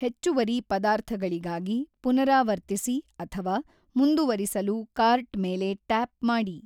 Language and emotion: Kannada, neutral